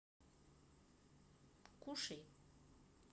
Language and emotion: Russian, neutral